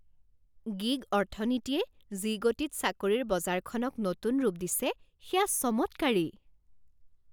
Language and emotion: Assamese, surprised